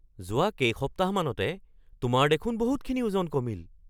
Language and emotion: Assamese, surprised